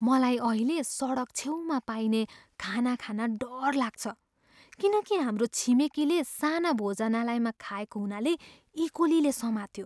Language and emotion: Nepali, fearful